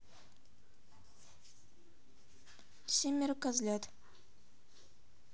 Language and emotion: Russian, neutral